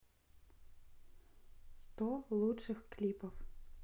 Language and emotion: Russian, neutral